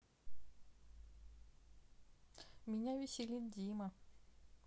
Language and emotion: Russian, sad